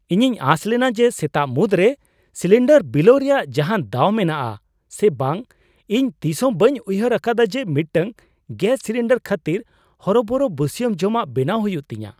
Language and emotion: Santali, surprised